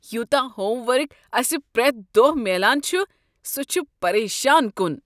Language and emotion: Kashmiri, disgusted